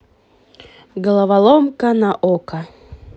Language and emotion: Russian, positive